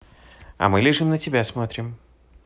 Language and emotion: Russian, positive